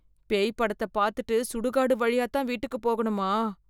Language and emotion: Tamil, fearful